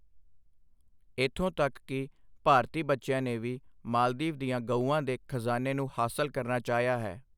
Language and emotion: Punjabi, neutral